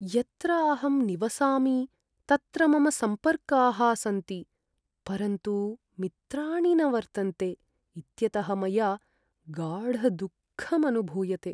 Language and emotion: Sanskrit, sad